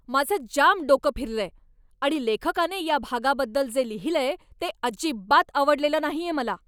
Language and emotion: Marathi, angry